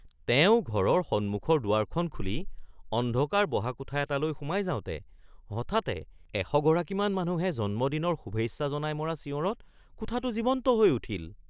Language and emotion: Assamese, surprised